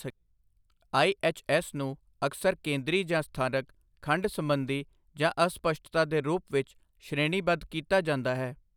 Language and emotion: Punjabi, neutral